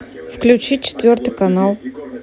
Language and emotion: Russian, neutral